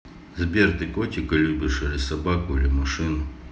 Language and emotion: Russian, neutral